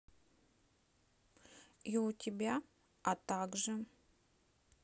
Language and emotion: Russian, neutral